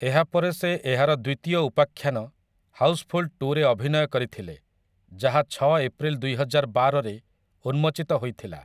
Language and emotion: Odia, neutral